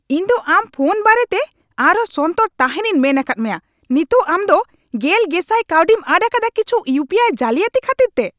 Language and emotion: Santali, angry